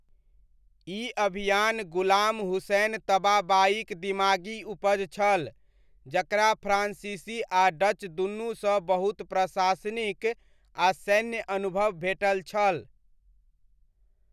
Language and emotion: Maithili, neutral